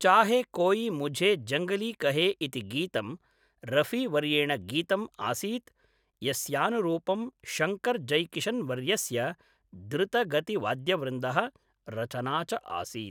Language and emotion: Sanskrit, neutral